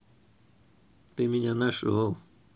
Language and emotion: Russian, positive